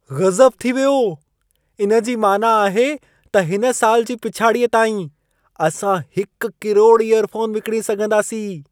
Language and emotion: Sindhi, surprised